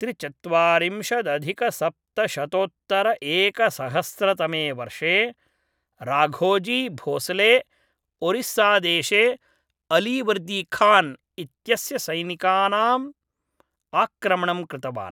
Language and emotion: Sanskrit, neutral